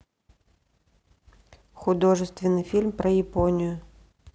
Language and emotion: Russian, neutral